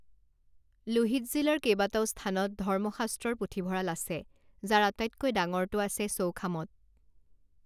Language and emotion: Assamese, neutral